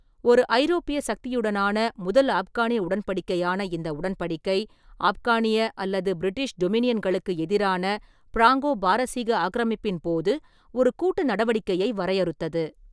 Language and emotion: Tamil, neutral